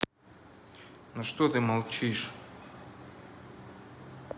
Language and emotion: Russian, angry